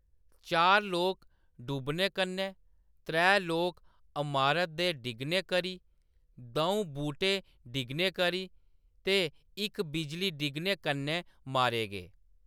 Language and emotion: Dogri, neutral